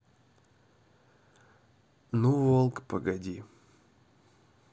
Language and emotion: Russian, neutral